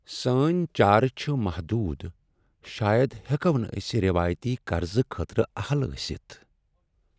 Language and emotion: Kashmiri, sad